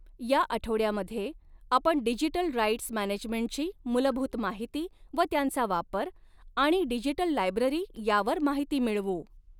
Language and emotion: Marathi, neutral